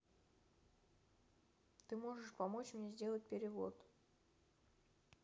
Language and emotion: Russian, neutral